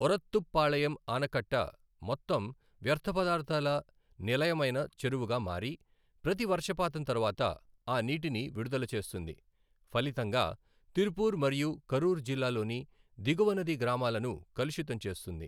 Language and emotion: Telugu, neutral